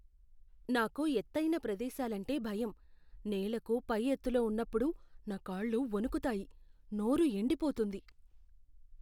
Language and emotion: Telugu, fearful